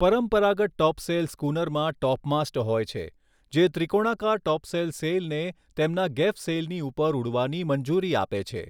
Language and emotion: Gujarati, neutral